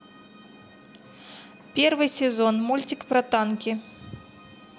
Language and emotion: Russian, neutral